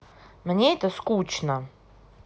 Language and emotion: Russian, angry